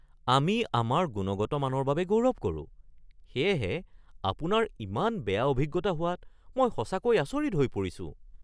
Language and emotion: Assamese, surprised